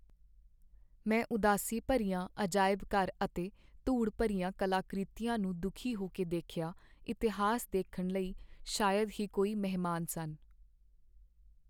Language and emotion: Punjabi, sad